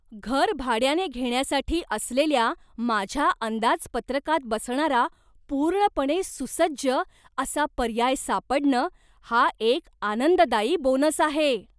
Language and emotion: Marathi, surprised